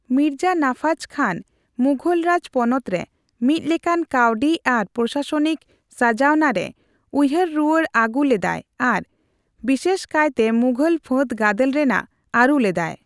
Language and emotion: Santali, neutral